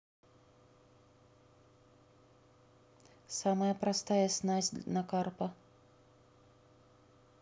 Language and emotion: Russian, neutral